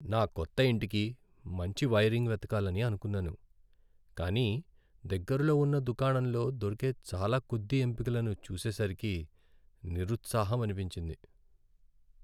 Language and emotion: Telugu, sad